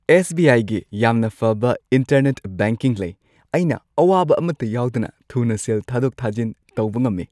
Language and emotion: Manipuri, happy